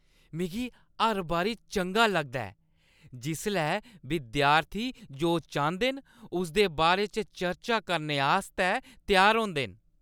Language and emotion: Dogri, happy